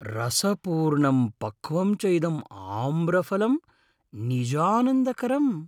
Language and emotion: Sanskrit, happy